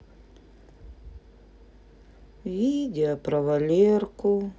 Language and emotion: Russian, sad